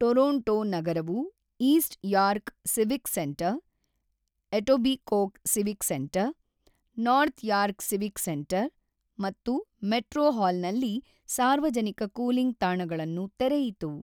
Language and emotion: Kannada, neutral